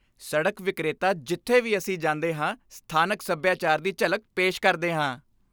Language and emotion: Punjabi, happy